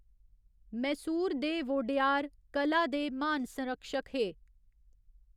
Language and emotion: Dogri, neutral